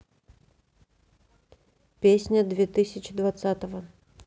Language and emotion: Russian, neutral